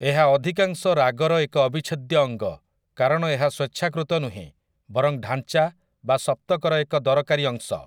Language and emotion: Odia, neutral